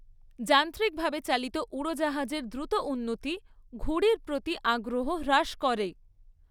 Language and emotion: Bengali, neutral